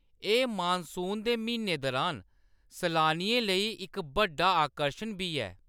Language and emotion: Dogri, neutral